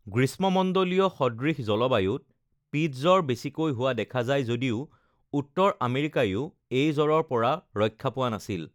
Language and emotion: Assamese, neutral